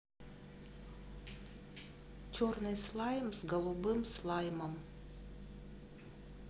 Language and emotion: Russian, neutral